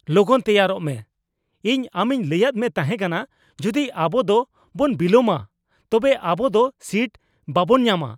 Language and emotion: Santali, angry